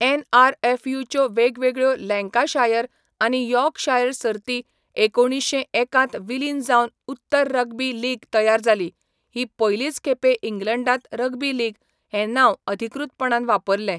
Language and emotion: Goan Konkani, neutral